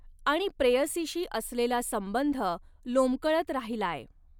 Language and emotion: Marathi, neutral